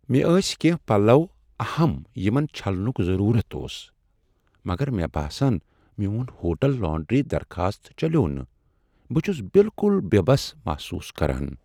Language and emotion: Kashmiri, sad